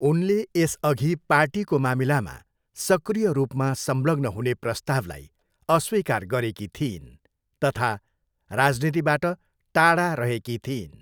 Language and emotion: Nepali, neutral